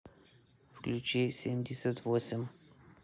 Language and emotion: Russian, neutral